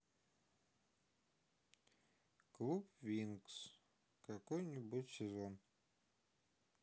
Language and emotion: Russian, sad